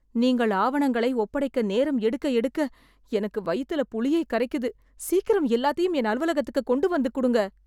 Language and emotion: Tamil, fearful